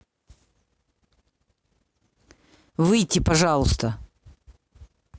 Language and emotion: Russian, angry